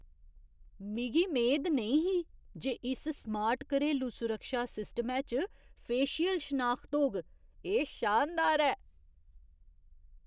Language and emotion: Dogri, surprised